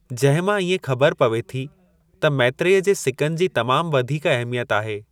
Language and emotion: Sindhi, neutral